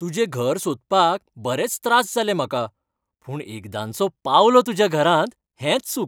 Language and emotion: Goan Konkani, happy